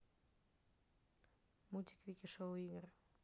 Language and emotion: Russian, neutral